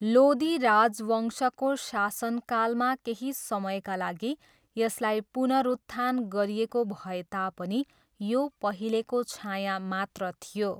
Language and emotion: Nepali, neutral